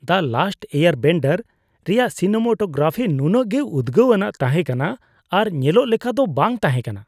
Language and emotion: Santali, disgusted